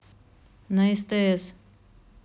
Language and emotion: Russian, neutral